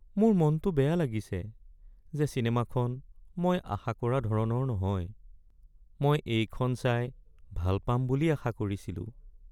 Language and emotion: Assamese, sad